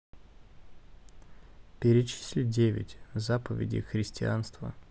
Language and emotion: Russian, neutral